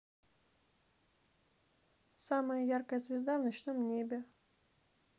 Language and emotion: Russian, neutral